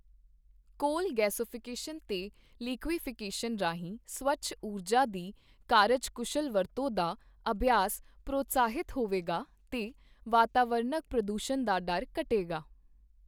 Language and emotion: Punjabi, neutral